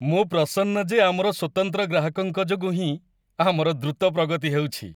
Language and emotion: Odia, happy